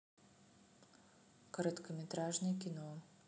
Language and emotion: Russian, neutral